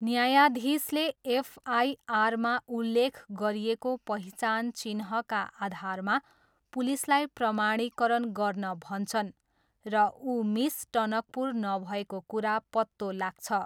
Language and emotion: Nepali, neutral